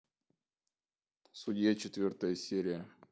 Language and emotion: Russian, neutral